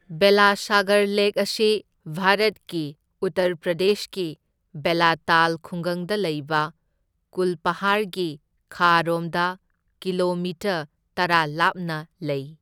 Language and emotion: Manipuri, neutral